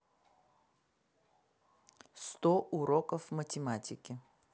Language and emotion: Russian, neutral